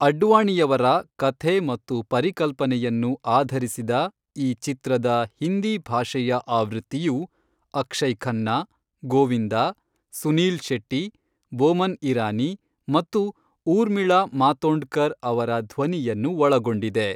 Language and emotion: Kannada, neutral